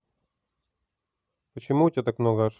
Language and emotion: Russian, neutral